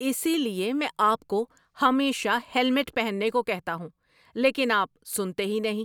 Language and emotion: Urdu, angry